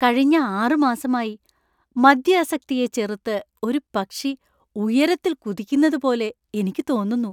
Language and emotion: Malayalam, happy